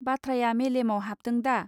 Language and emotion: Bodo, neutral